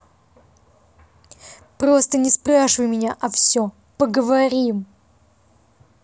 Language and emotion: Russian, angry